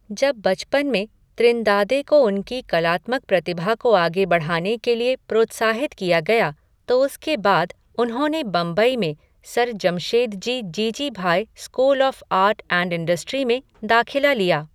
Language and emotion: Hindi, neutral